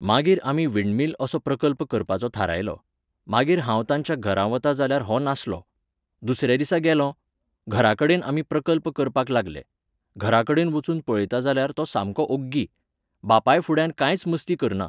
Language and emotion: Goan Konkani, neutral